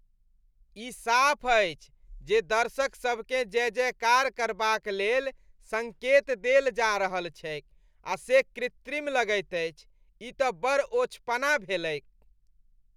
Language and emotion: Maithili, disgusted